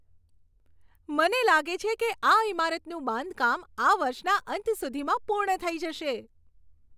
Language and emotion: Gujarati, happy